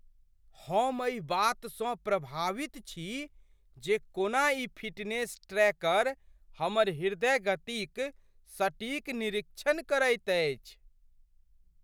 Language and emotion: Maithili, surprised